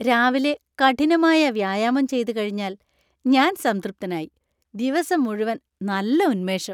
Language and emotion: Malayalam, happy